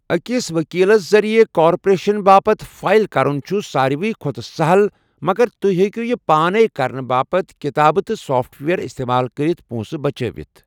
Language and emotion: Kashmiri, neutral